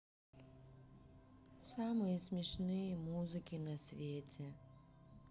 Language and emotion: Russian, sad